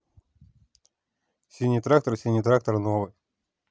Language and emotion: Russian, neutral